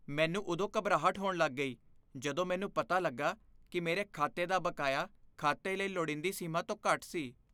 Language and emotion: Punjabi, fearful